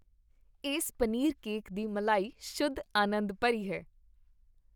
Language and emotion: Punjabi, happy